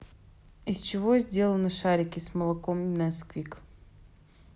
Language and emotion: Russian, neutral